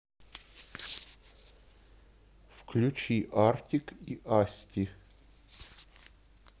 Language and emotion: Russian, neutral